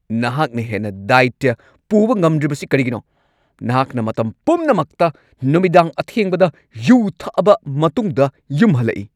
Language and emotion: Manipuri, angry